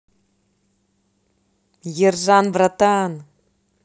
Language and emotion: Russian, positive